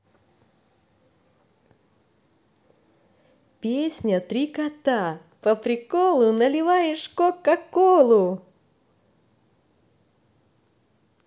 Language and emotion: Russian, positive